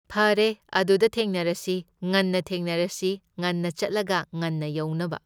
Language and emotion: Manipuri, neutral